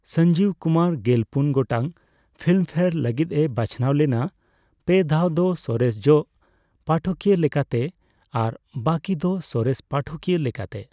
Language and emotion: Santali, neutral